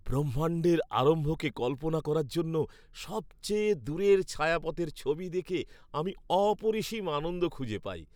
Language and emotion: Bengali, happy